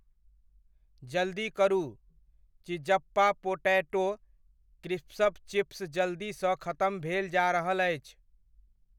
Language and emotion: Maithili, neutral